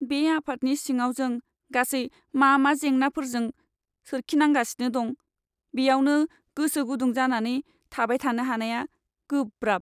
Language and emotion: Bodo, sad